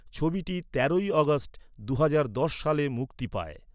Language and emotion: Bengali, neutral